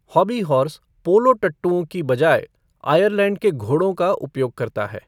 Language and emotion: Hindi, neutral